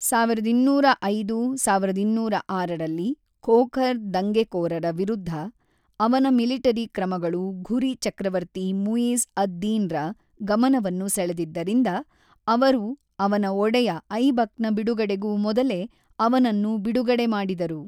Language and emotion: Kannada, neutral